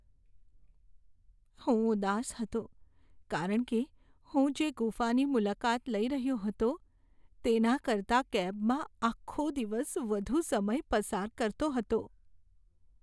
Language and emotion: Gujarati, sad